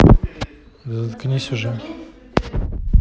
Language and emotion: Russian, neutral